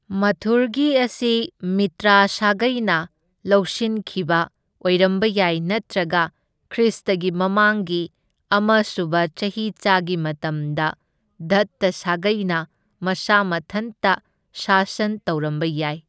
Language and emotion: Manipuri, neutral